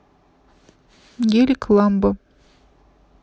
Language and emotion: Russian, neutral